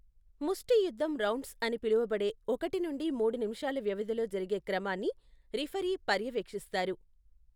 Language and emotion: Telugu, neutral